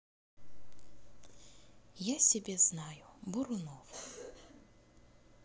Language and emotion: Russian, neutral